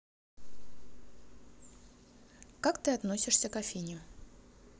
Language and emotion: Russian, neutral